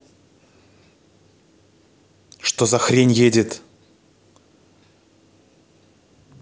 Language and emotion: Russian, angry